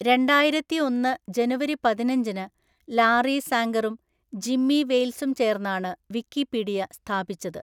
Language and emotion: Malayalam, neutral